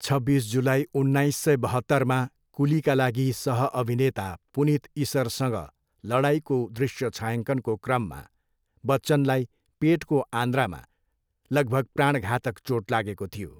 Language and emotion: Nepali, neutral